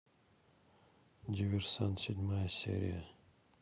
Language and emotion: Russian, neutral